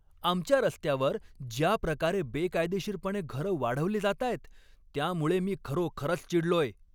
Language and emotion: Marathi, angry